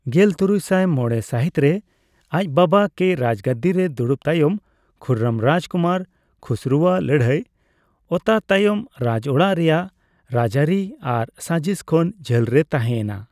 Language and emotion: Santali, neutral